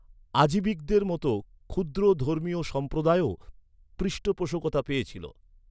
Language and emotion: Bengali, neutral